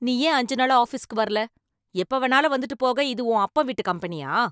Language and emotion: Tamil, angry